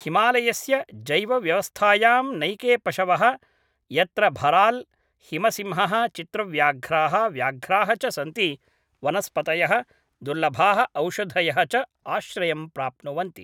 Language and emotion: Sanskrit, neutral